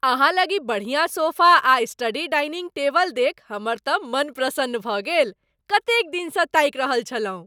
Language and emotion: Maithili, happy